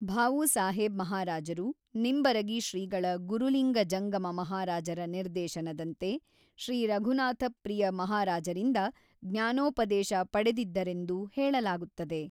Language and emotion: Kannada, neutral